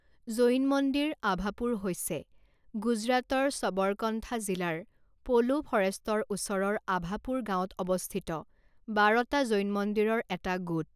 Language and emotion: Assamese, neutral